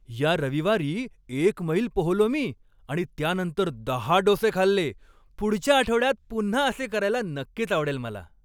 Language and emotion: Marathi, happy